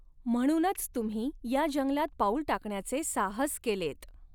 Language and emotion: Marathi, neutral